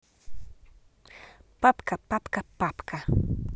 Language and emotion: Russian, positive